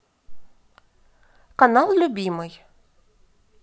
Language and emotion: Russian, neutral